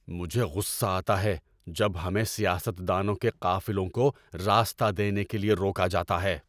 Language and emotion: Urdu, angry